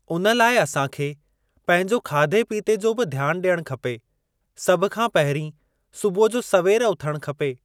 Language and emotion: Sindhi, neutral